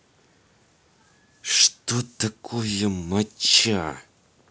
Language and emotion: Russian, angry